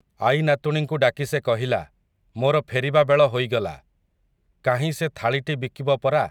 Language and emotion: Odia, neutral